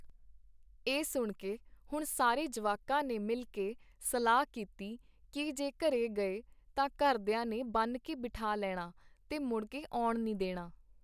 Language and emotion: Punjabi, neutral